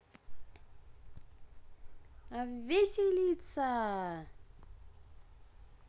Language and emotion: Russian, positive